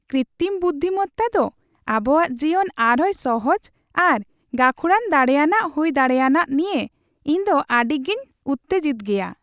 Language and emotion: Santali, happy